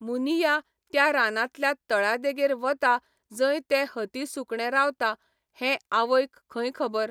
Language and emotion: Goan Konkani, neutral